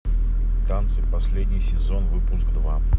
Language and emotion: Russian, neutral